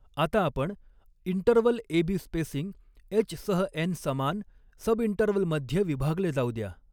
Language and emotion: Marathi, neutral